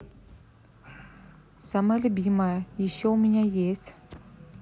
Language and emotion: Russian, neutral